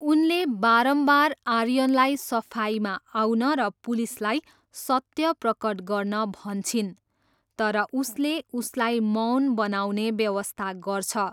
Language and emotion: Nepali, neutral